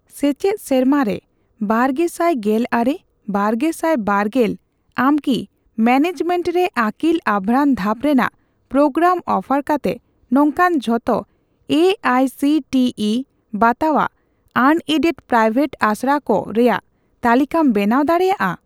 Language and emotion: Santali, neutral